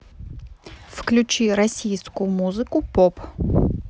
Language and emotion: Russian, neutral